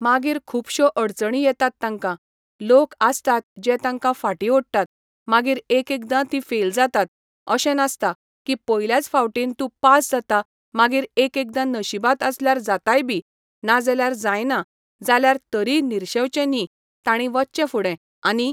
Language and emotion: Goan Konkani, neutral